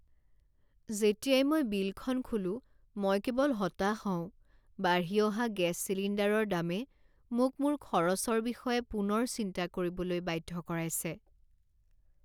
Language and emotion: Assamese, sad